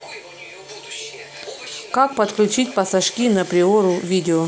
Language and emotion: Russian, neutral